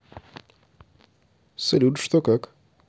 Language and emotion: Russian, neutral